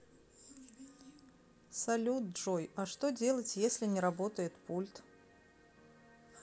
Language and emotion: Russian, neutral